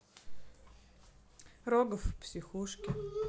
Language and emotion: Russian, neutral